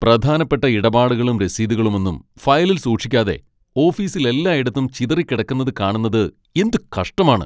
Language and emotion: Malayalam, angry